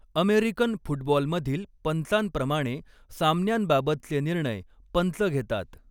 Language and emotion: Marathi, neutral